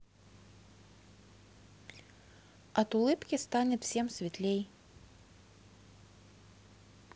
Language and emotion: Russian, neutral